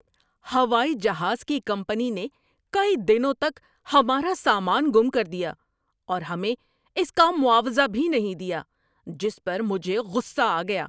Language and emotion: Urdu, angry